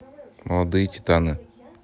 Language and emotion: Russian, neutral